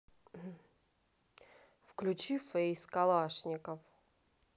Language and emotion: Russian, neutral